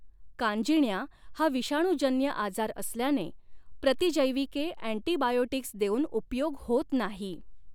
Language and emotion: Marathi, neutral